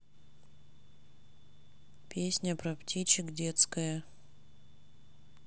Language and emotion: Russian, neutral